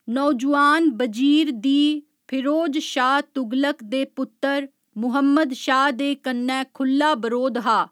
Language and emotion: Dogri, neutral